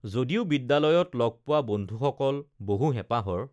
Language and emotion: Assamese, neutral